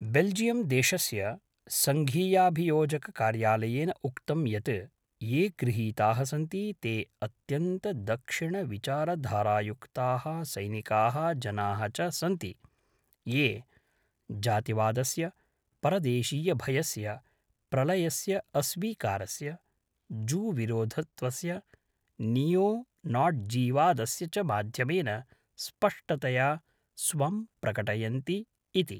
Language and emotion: Sanskrit, neutral